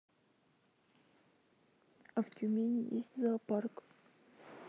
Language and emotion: Russian, sad